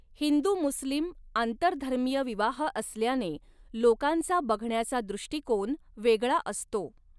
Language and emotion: Marathi, neutral